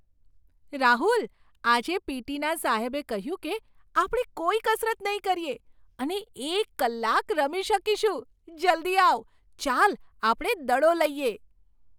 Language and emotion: Gujarati, surprised